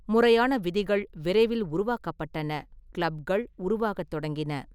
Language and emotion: Tamil, neutral